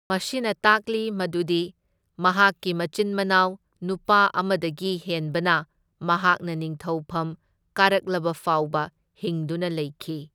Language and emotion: Manipuri, neutral